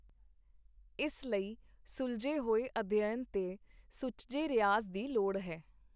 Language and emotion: Punjabi, neutral